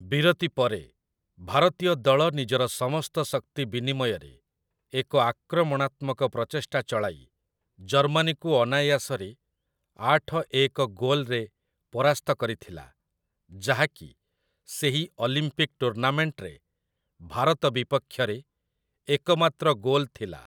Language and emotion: Odia, neutral